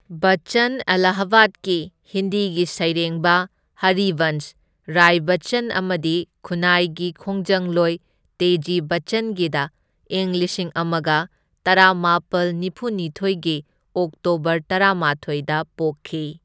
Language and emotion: Manipuri, neutral